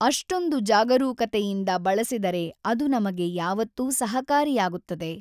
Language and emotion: Kannada, neutral